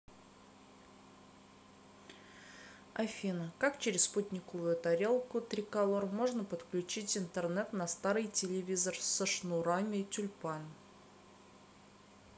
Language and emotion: Russian, neutral